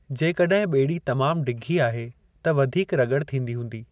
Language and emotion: Sindhi, neutral